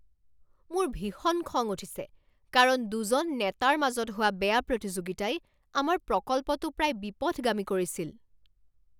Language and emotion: Assamese, angry